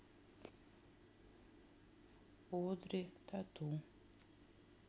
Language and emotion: Russian, sad